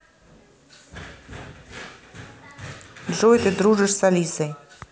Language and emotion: Russian, neutral